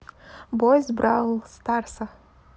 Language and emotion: Russian, neutral